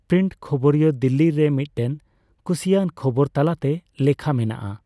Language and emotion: Santali, neutral